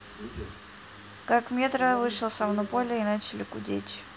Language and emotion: Russian, neutral